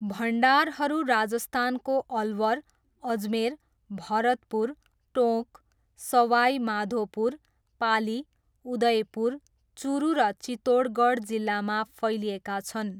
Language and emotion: Nepali, neutral